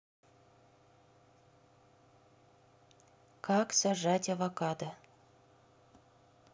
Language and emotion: Russian, neutral